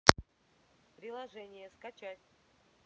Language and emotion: Russian, neutral